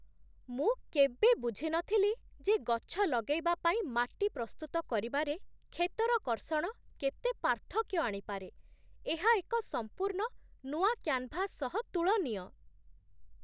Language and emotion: Odia, surprised